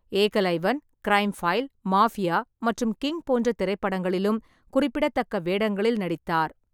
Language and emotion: Tamil, neutral